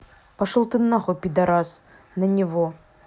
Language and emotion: Russian, angry